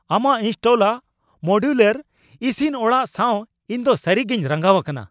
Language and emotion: Santali, angry